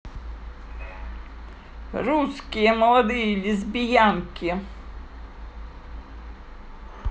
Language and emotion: Russian, positive